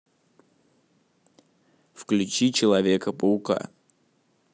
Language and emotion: Russian, neutral